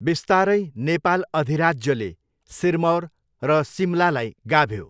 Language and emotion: Nepali, neutral